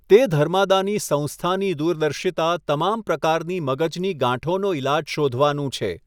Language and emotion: Gujarati, neutral